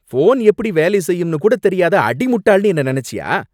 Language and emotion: Tamil, angry